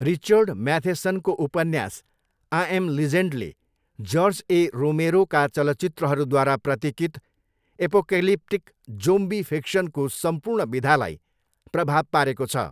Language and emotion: Nepali, neutral